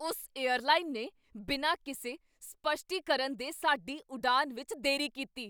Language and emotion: Punjabi, angry